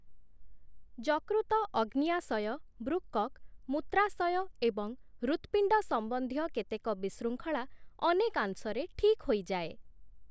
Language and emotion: Odia, neutral